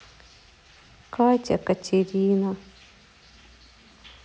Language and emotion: Russian, sad